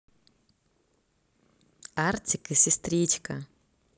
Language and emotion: Russian, positive